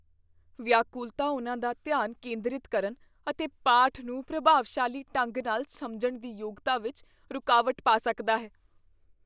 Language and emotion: Punjabi, fearful